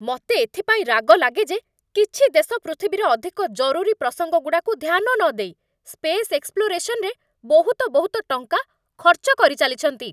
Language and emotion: Odia, angry